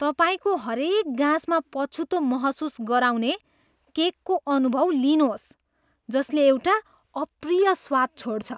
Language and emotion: Nepali, disgusted